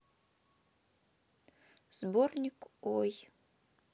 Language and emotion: Russian, neutral